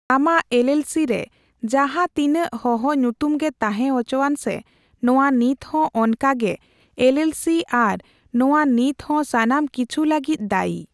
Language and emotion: Santali, neutral